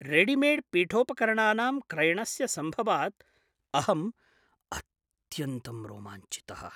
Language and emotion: Sanskrit, surprised